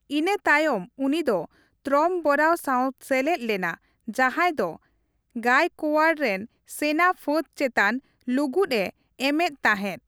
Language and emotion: Santali, neutral